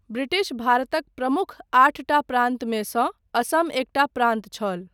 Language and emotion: Maithili, neutral